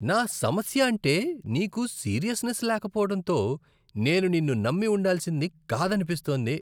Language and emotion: Telugu, disgusted